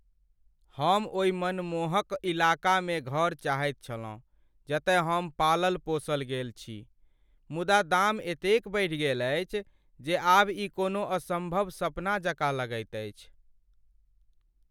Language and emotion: Maithili, sad